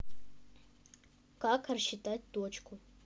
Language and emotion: Russian, neutral